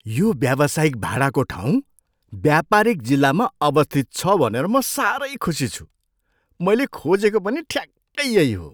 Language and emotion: Nepali, surprised